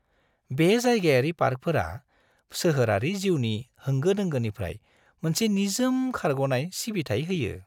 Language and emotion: Bodo, happy